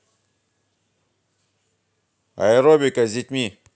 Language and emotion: Russian, positive